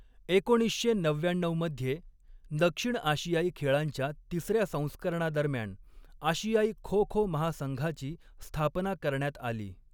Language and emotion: Marathi, neutral